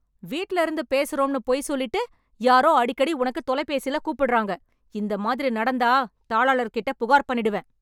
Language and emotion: Tamil, angry